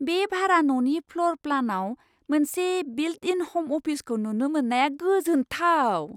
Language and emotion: Bodo, surprised